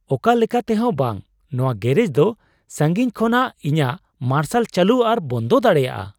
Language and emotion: Santali, surprised